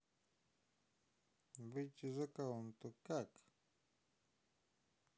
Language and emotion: Russian, neutral